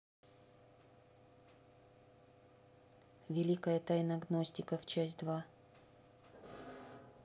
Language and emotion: Russian, neutral